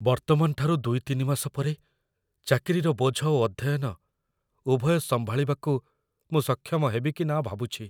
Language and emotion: Odia, fearful